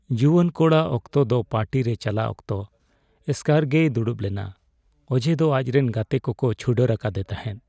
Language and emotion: Santali, sad